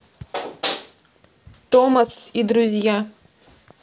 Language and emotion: Russian, neutral